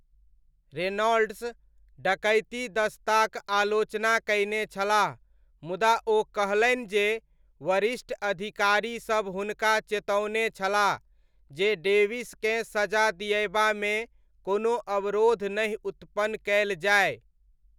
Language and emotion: Maithili, neutral